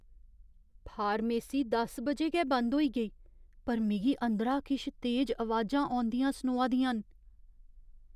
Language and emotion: Dogri, fearful